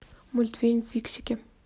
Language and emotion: Russian, neutral